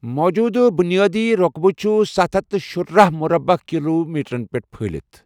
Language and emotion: Kashmiri, neutral